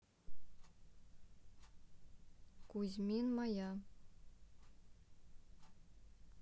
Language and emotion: Russian, neutral